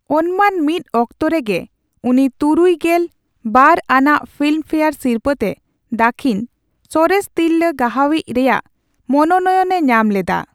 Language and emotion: Santali, neutral